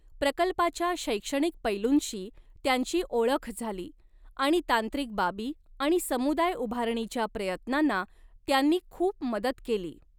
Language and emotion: Marathi, neutral